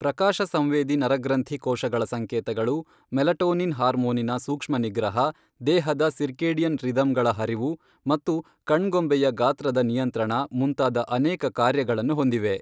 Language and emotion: Kannada, neutral